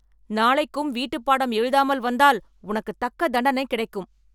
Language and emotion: Tamil, angry